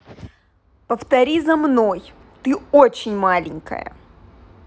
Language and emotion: Russian, angry